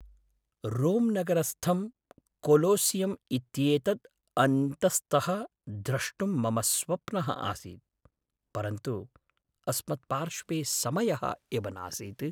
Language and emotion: Sanskrit, sad